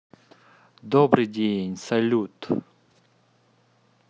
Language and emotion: Russian, positive